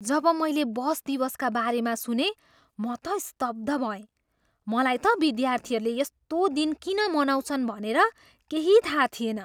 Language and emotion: Nepali, surprised